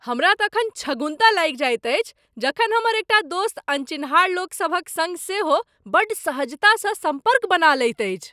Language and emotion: Maithili, surprised